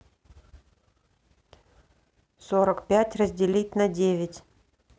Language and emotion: Russian, neutral